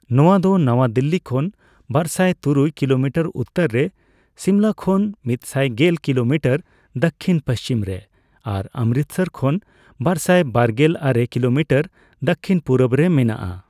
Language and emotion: Santali, neutral